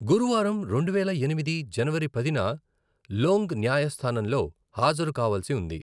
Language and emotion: Telugu, neutral